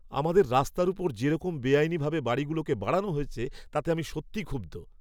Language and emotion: Bengali, angry